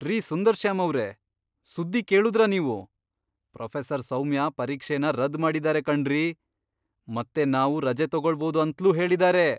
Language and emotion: Kannada, surprised